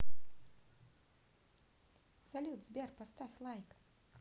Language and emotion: Russian, positive